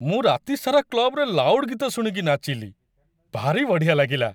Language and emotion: Odia, happy